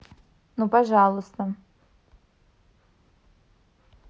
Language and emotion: Russian, neutral